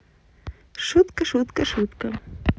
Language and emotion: Russian, positive